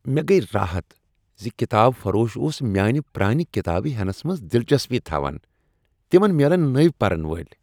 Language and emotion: Kashmiri, happy